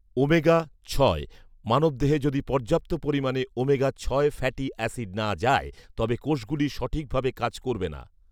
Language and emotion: Bengali, neutral